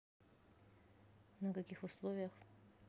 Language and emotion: Russian, neutral